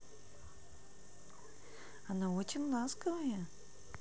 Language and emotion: Russian, positive